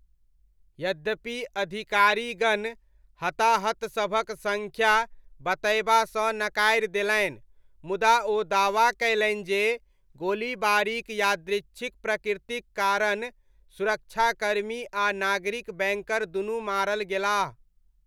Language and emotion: Maithili, neutral